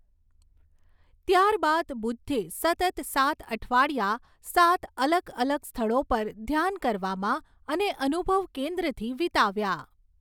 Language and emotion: Gujarati, neutral